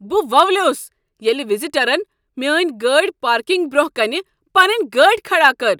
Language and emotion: Kashmiri, angry